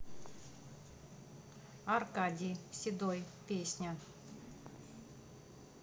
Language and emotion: Russian, neutral